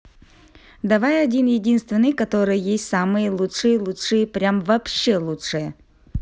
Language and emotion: Russian, neutral